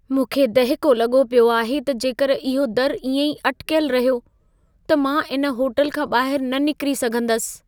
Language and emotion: Sindhi, fearful